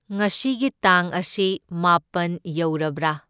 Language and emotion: Manipuri, neutral